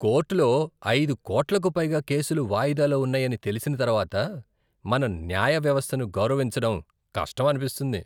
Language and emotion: Telugu, disgusted